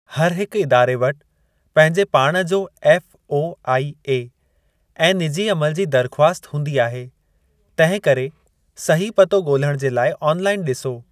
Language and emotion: Sindhi, neutral